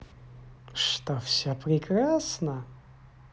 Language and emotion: Russian, positive